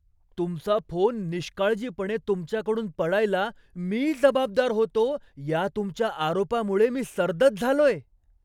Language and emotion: Marathi, surprised